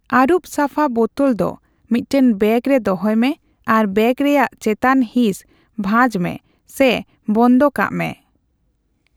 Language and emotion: Santali, neutral